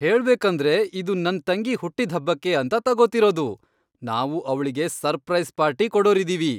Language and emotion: Kannada, happy